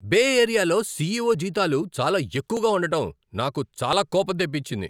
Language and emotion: Telugu, angry